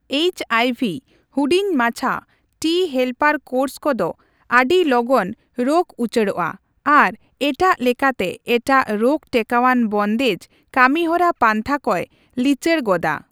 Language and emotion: Santali, neutral